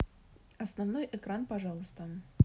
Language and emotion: Russian, neutral